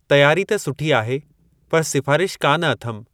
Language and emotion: Sindhi, neutral